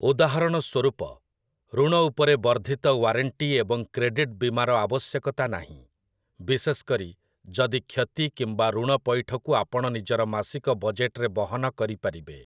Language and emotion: Odia, neutral